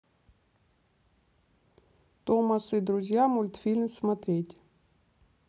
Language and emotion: Russian, neutral